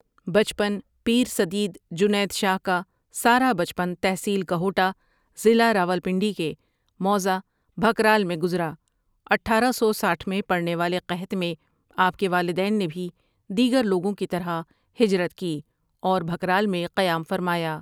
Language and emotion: Urdu, neutral